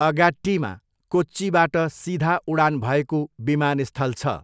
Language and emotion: Nepali, neutral